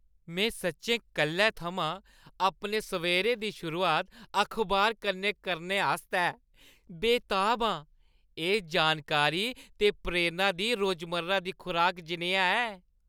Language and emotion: Dogri, happy